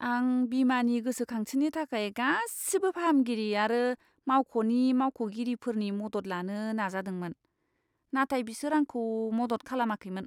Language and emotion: Bodo, disgusted